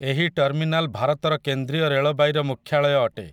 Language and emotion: Odia, neutral